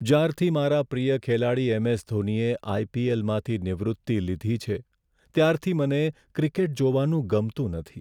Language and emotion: Gujarati, sad